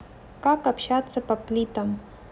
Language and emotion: Russian, neutral